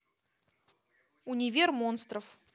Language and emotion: Russian, neutral